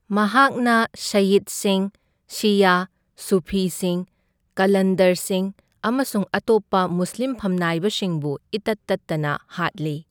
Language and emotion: Manipuri, neutral